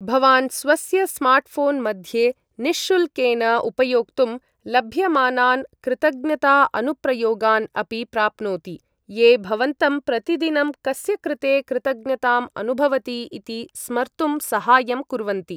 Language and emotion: Sanskrit, neutral